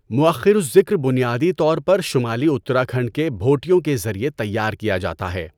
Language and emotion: Urdu, neutral